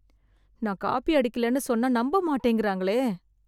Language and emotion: Tamil, sad